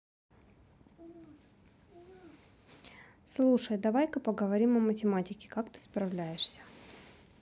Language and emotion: Russian, neutral